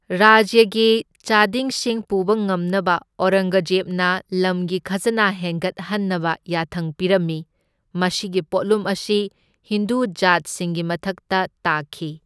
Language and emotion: Manipuri, neutral